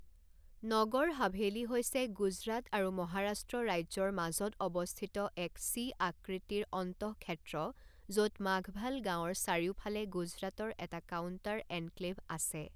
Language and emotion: Assamese, neutral